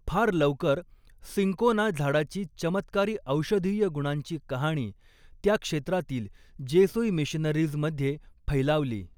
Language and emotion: Marathi, neutral